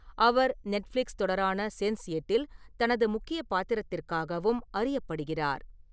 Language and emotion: Tamil, neutral